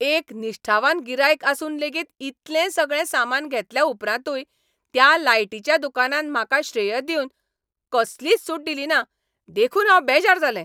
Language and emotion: Goan Konkani, angry